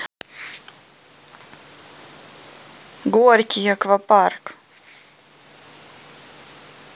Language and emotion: Russian, neutral